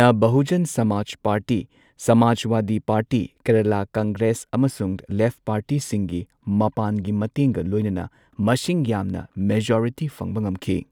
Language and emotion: Manipuri, neutral